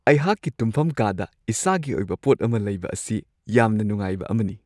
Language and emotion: Manipuri, happy